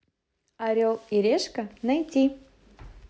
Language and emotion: Russian, positive